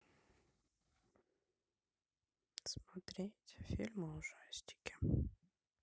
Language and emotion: Russian, sad